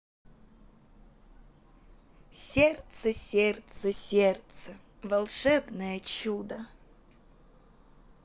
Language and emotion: Russian, positive